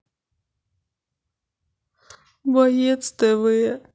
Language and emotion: Russian, sad